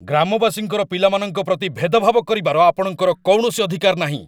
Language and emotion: Odia, angry